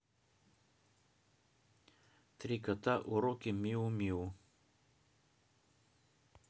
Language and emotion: Russian, neutral